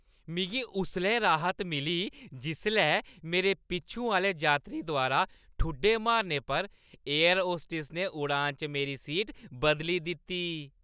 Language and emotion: Dogri, happy